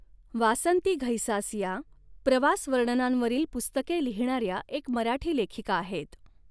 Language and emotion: Marathi, neutral